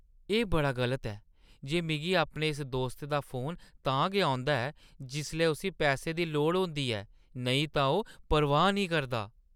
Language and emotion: Dogri, disgusted